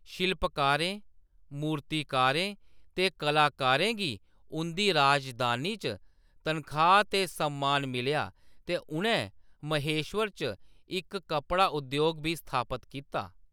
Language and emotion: Dogri, neutral